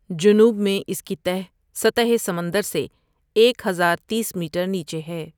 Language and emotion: Urdu, neutral